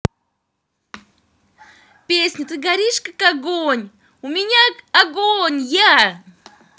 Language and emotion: Russian, positive